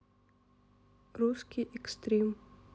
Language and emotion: Russian, neutral